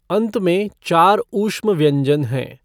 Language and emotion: Hindi, neutral